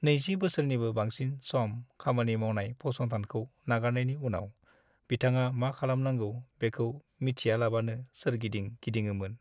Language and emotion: Bodo, sad